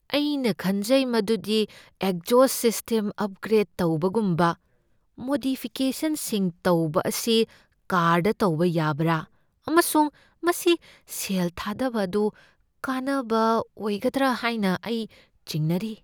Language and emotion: Manipuri, fearful